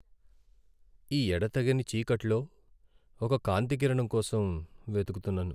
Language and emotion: Telugu, sad